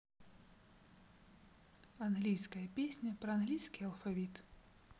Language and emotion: Russian, neutral